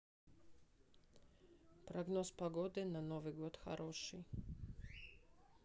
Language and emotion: Russian, neutral